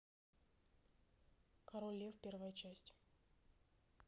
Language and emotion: Russian, neutral